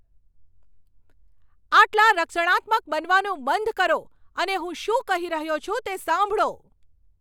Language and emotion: Gujarati, angry